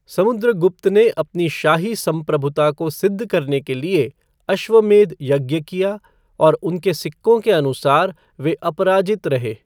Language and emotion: Hindi, neutral